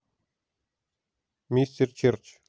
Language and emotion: Russian, neutral